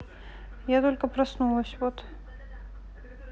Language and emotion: Russian, neutral